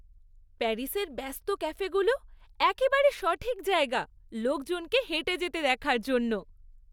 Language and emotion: Bengali, happy